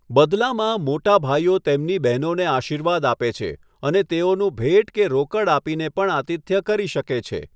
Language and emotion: Gujarati, neutral